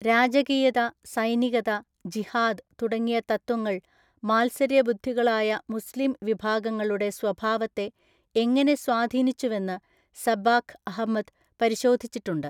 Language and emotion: Malayalam, neutral